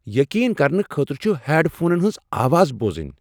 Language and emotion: Kashmiri, surprised